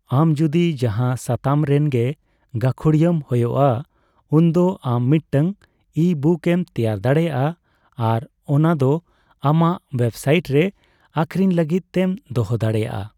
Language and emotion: Santali, neutral